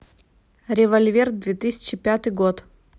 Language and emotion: Russian, neutral